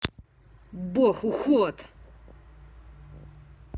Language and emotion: Russian, angry